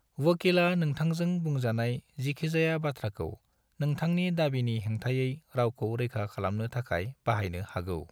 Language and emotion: Bodo, neutral